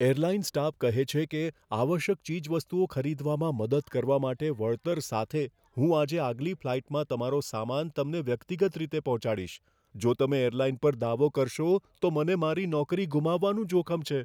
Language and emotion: Gujarati, fearful